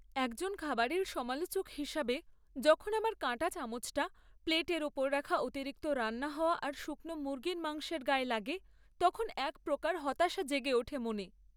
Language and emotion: Bengali, sad